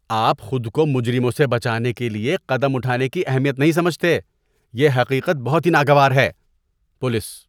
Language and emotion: Urdu, disgusted